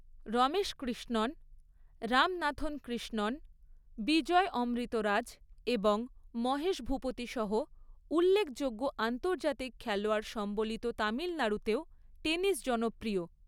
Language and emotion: Bengali, neutral